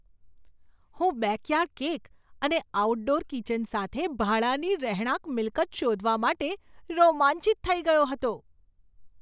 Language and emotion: Gujarati, surprised